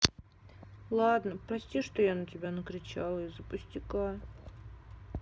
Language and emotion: Russian, sad